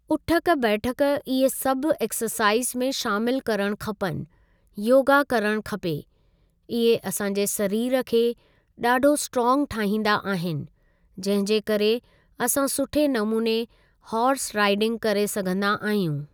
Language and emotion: Sindhi, neutral